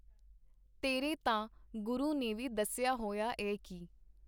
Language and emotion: Punjabi, neutral